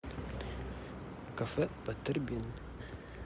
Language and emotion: Russian, neutral